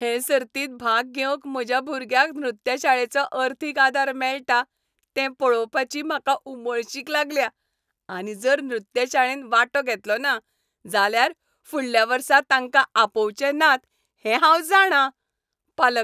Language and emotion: Goan Konkani, happy